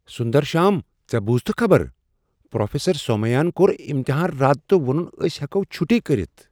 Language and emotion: Kashmiri, surprised